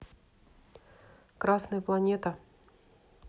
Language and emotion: Russian, neutral